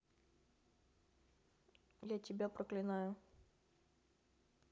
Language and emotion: Russian, angry